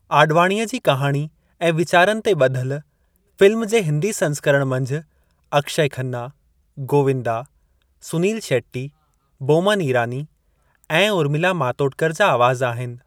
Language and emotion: Sindhi, neutral